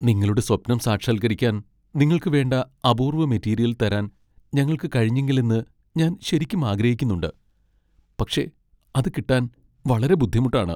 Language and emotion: Malayalam, sad